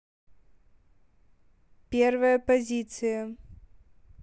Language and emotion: Russian, neutral